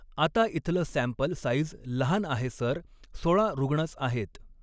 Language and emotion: Marathi, neutral